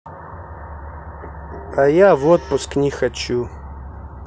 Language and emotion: Russian, neutral